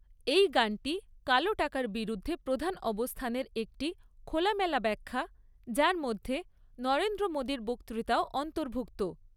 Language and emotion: Bengali, neutral